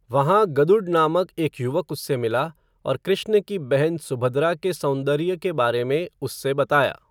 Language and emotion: Hindi, neutral